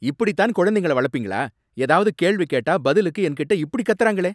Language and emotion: Tamil, angry